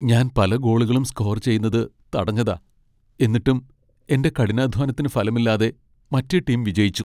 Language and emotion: Malayalam, sad